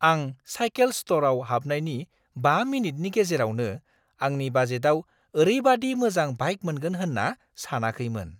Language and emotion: Bodo, surprised